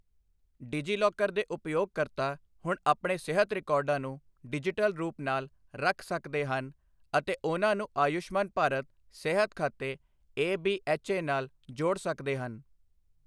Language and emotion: Punjabi, neutral